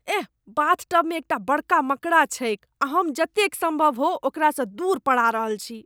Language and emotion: Maithili, disgusted